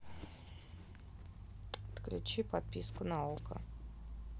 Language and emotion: Russian, neutral